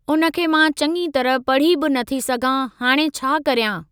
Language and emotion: Sindhi, neutral